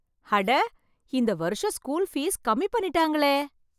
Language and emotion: Tamil, surprised